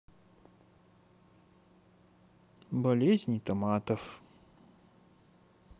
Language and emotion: Russian, neutral